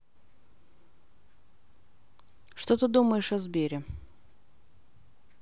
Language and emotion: Russian, neutral